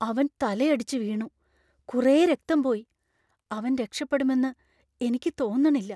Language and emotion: Malayalam, fearful